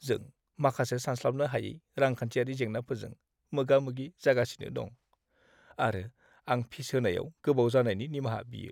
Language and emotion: Bodo, sad